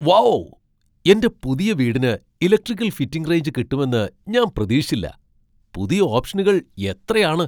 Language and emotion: Malayalam, surprised